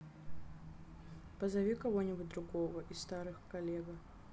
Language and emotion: Russian, neutral